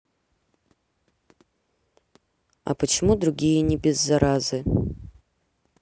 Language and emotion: Russian, neutral